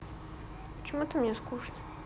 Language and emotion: Russian, sad